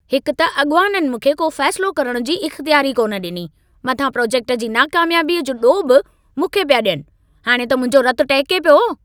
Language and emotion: Sindhi, angry